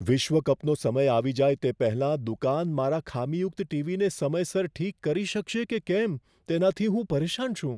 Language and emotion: Gujarati, fearful